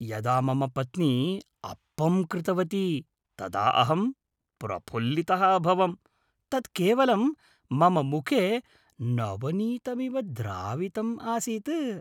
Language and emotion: Sanskrit, happy